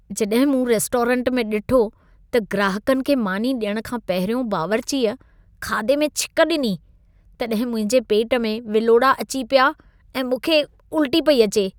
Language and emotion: Sindhi, disgusted